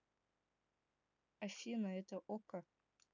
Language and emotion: Russian, neutral